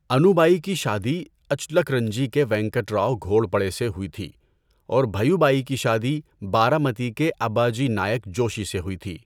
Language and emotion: Urdu, neutral